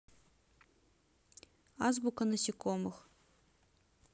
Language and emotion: Russian, neutral